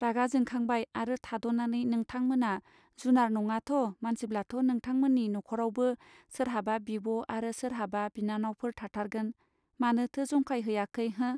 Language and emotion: Bodo, neutral